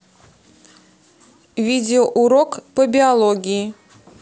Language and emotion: Russian, neutral